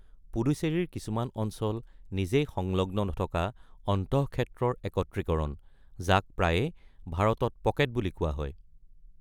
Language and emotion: Assamese, neutral